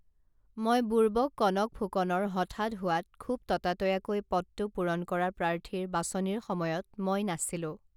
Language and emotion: Assamese, neutral